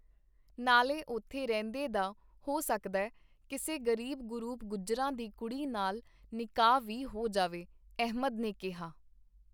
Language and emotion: Punjabi, neutral